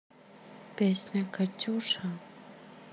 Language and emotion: Russian, neutral